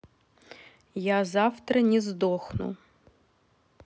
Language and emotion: Russian, neutral